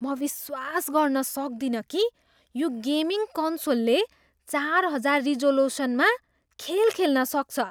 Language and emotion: Nepali, surprised